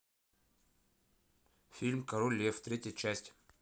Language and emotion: Russian, neutral